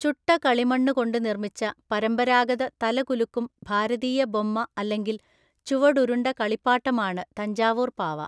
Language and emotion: Malayalam, neutral